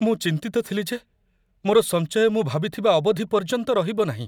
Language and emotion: Odia, fearful